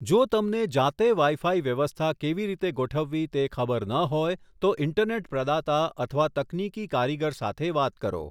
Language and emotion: Gujarati, neutral